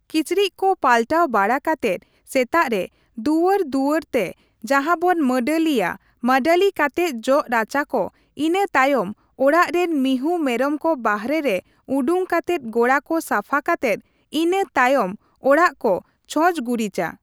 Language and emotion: Santali, neutral